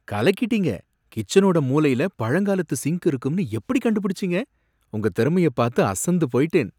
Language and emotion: Tamil, surprised